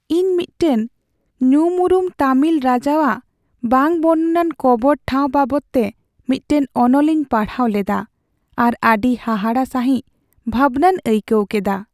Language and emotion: Santali, sad